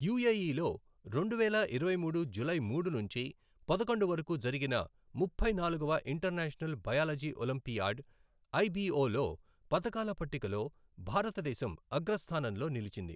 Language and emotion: Telugu, neutral